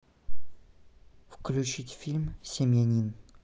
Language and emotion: Russian, neutral